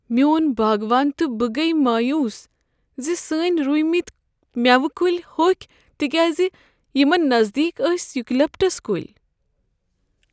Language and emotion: Kashmiri, sad